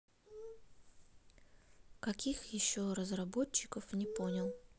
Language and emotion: Russian, neutral